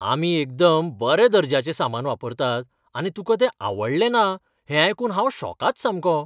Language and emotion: Goan Konkani, surprised